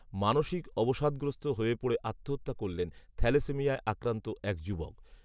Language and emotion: Bengali, neutral